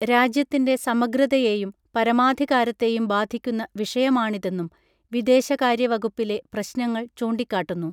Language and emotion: Malayalam, neutral